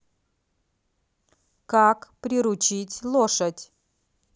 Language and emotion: Russian, positive